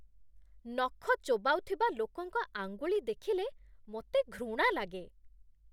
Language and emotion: Odia, disgusted